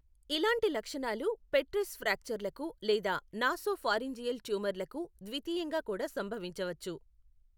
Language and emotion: Telugu, neutral